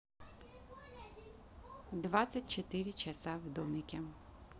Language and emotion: Russian, neutral